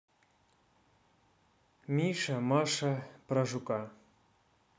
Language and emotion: Russian, neutral